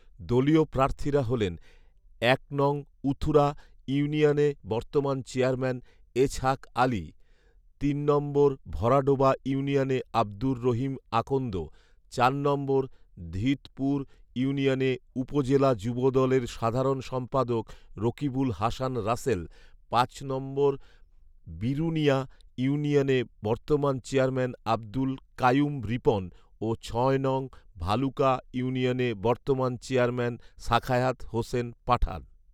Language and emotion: Bengali, neutral